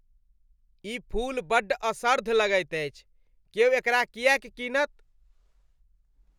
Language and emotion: Maithili, disgusted